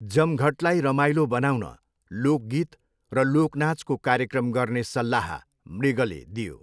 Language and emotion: Nepali, neutral